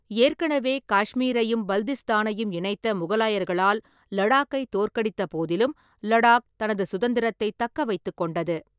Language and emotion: Tamil, neutral